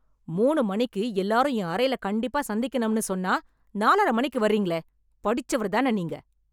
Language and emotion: Tamil, angry